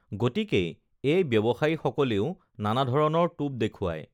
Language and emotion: Assamese, neutral